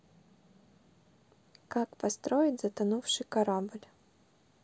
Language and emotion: Russian, neutral